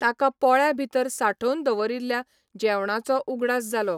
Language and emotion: Goan Konkani, neutral